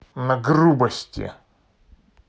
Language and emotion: Russian, angry